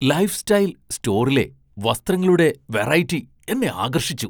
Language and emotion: Malayalam, surprised